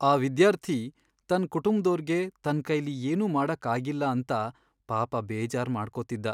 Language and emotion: Kannada, sad